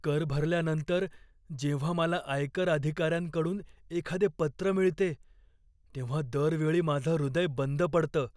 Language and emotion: Marathi, fearful